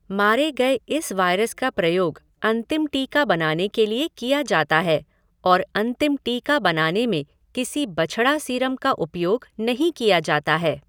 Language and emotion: Hindi, neutral